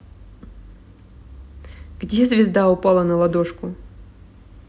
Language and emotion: Russian, neutral